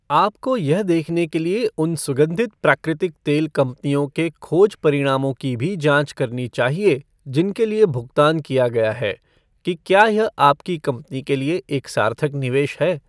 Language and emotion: Hindi, neutral